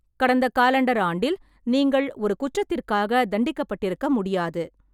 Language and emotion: Tamil, neutral